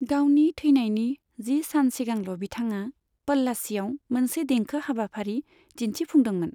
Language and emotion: Bodo, neutral